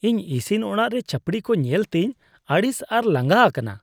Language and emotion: Santali, disgusted